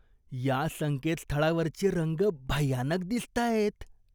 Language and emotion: Marathi, disgusted